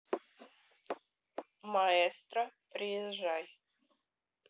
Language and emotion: Russian, neutral